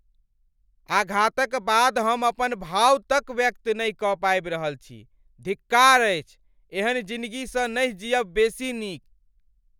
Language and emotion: Maithili, angry